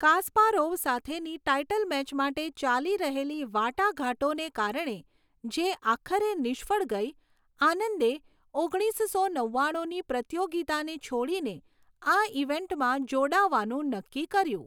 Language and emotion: Gujarati, neutral